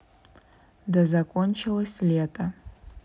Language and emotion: Russian, neutral